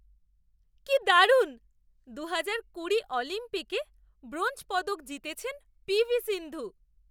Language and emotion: Bengali, surprised